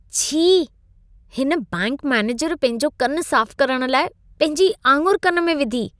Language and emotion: Sindhi, disgusted